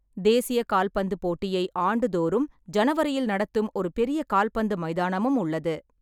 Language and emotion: Tamil, neutral